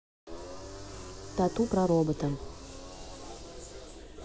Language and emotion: Russian, neutral